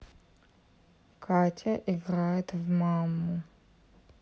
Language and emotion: Russian, neutral